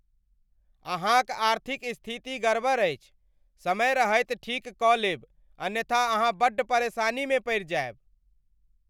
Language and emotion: Maithili, angry